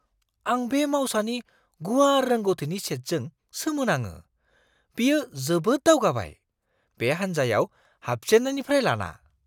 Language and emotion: Bodo, surprised